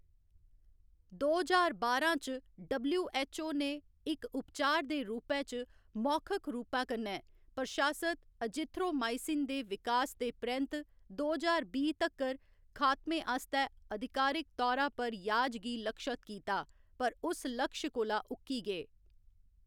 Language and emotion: Dogri, neutral